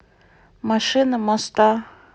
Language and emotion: Russian, neutral